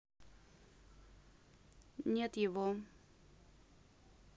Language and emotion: Russian, neutral